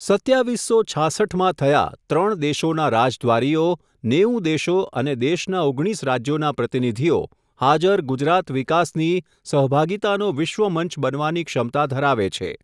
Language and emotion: Gujarati, neutral